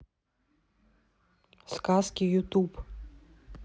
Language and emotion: Russian, neutral